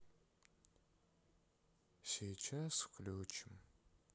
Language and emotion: Russian, sad